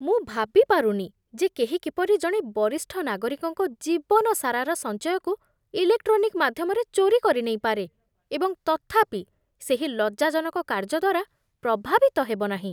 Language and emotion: Odia, disgusted